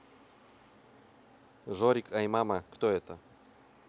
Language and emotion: Russian, neutral